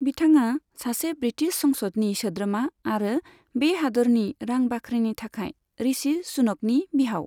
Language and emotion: Bodo, neutral